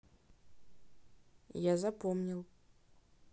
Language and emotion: Russian, neutral